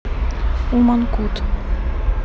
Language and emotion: Russian, neutral